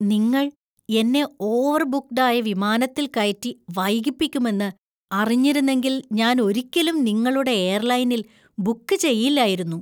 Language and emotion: Malayalam, disgusted